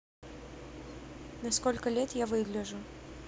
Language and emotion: Russian, neutral